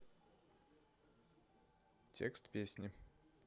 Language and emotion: Russian, neutral